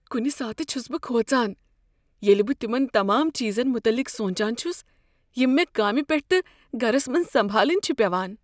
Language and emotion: Kashmiri, fearful